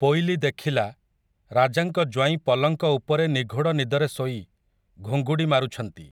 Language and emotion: Odia, neutral